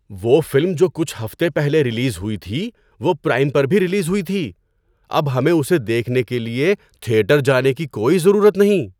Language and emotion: Urdu, surprised